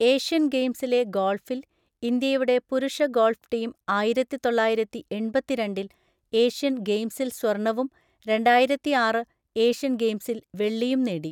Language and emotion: Malayalam, neutral